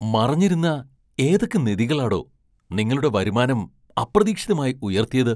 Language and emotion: Malayalam, surprised